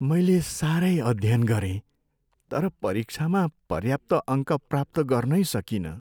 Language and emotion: Nepali, sad